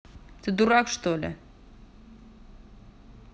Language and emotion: Russian, angry